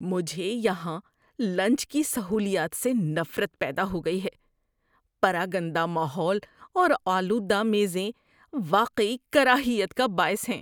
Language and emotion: Urdu, disgusted